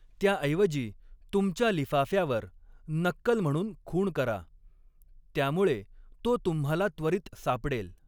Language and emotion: Marathi, neutral